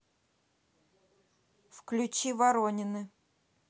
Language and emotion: Russian, neutral